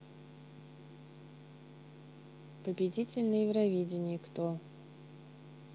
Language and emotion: Russian, neutral